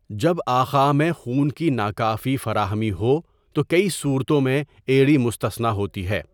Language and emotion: Urdu, neutral